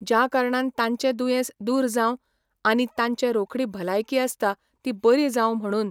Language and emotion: Goan Konkani, neutral